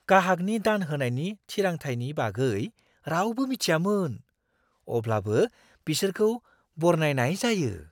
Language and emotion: Bodo, surprised